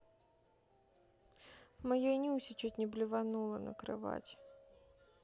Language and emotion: Russian, sad